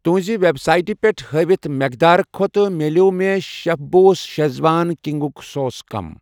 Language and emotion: Kashmiri, neutral